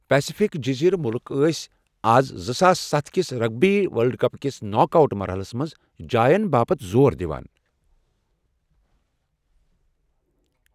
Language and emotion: Kashmiri, neutral